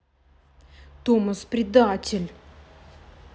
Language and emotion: Russian, angry